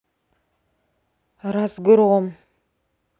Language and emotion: Russian, sad